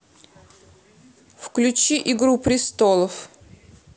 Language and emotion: Russian, neutral